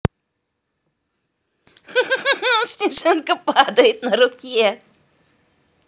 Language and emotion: Russian, positive